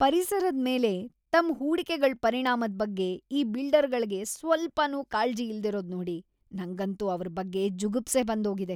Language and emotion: Kannada, disgusted